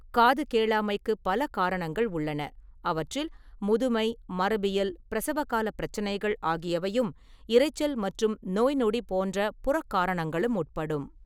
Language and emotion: Tamil, neutral